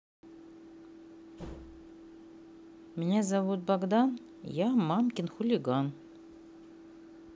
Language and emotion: Russian, neutral